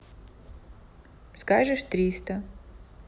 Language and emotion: Russian, neutral